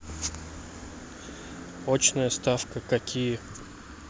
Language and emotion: Russian, neutral